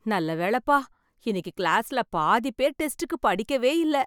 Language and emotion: Tamil, happy